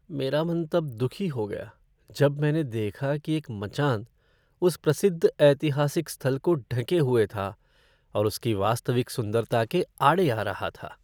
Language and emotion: Hindi, sad